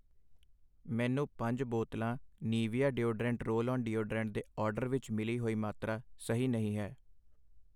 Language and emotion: Punjabi, neutral